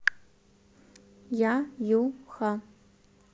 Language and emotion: Russian, neutral